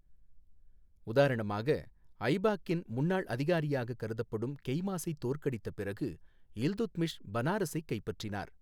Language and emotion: Tamil, neutral